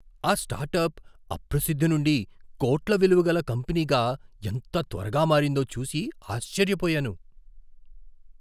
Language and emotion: Telugu, surprised